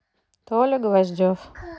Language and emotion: Russian, neutral